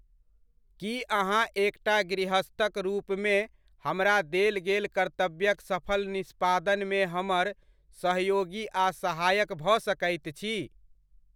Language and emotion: Maithili, neutral